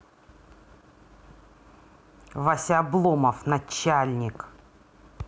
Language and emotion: Russian, angry